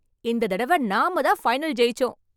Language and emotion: Tamil, happy